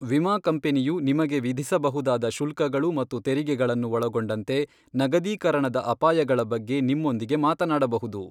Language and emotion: Kannada, neutral